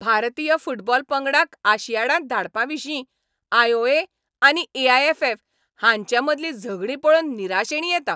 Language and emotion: Goan Konkani, angry